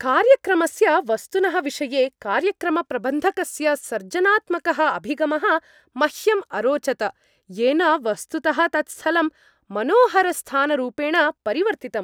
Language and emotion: Sanskrit, happy